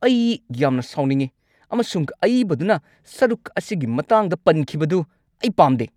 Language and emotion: Manipuri, angry